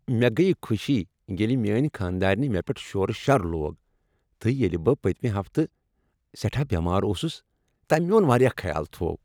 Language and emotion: Kashmiri, happy